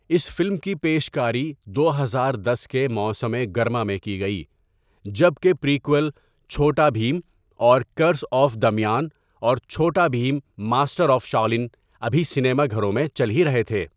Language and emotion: Urdu, neutral